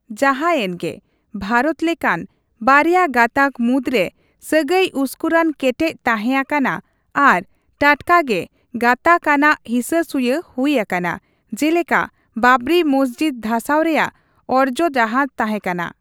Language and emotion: Santali, neutral